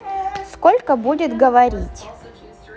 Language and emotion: Russian, neutral